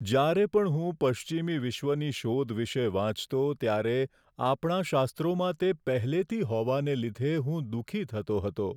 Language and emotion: Gujarati, sad